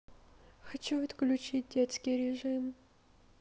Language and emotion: Russian, sad